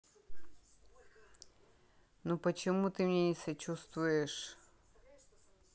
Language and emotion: Russian, neutral